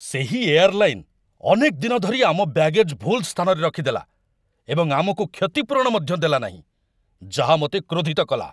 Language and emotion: Odia, angry